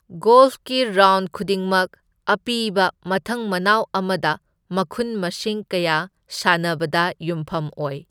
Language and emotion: Manipuri, neutral